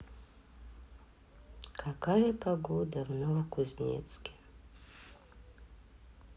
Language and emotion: Russian, sad